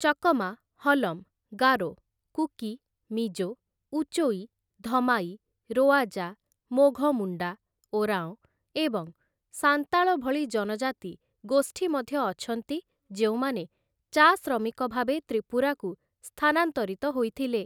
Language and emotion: Odia, neutral